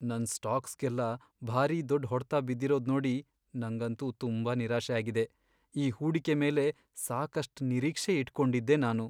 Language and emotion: Kannada, sad